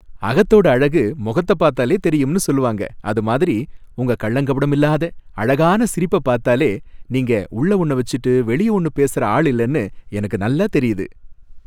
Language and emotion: Tamil, happy